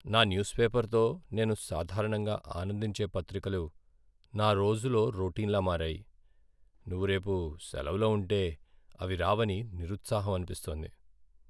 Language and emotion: Telugu, sad